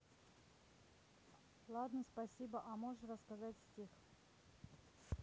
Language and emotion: Russian, neutral